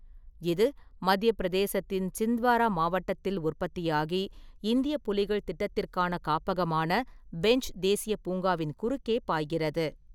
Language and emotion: Tamil, neutral